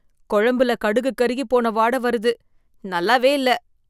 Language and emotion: Tamil, disgusted